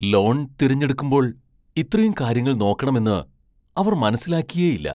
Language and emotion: Malayalam, surprised